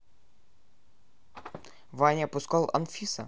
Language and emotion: Russian, neutral